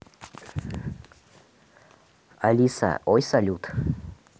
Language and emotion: Russian, neutral